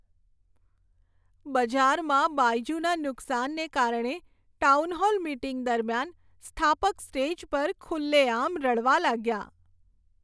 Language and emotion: Gujarati, sad